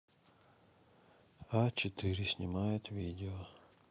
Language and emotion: Russian, sad